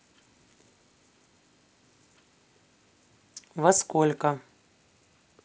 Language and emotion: Russian, neutral